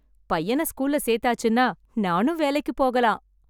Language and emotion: Tamil, happy